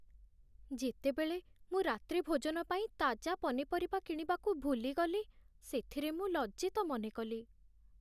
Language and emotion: Odia, sad